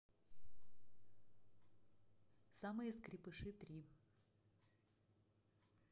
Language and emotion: Russian, neutral